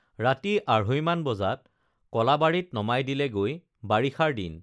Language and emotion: Assamese, neutral